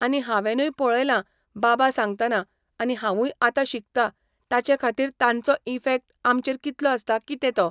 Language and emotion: Goan Konkani, neutral